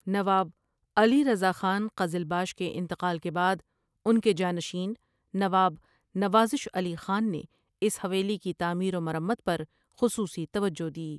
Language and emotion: Urdu, neutral